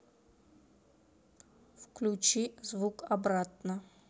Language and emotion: Russian, neutral